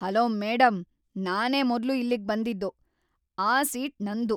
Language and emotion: Kannada, angry